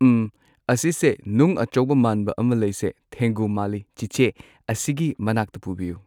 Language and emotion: Manipuri, neutral